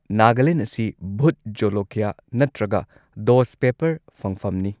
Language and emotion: Manipuri, neutral